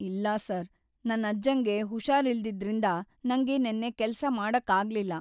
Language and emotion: Kannada, sad